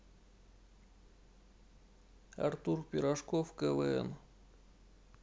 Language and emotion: Russian, neutral